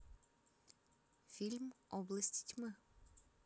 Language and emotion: Russian, neutral